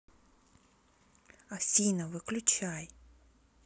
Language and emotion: Russian, neutral